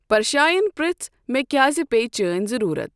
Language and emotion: Kashmiri, neutral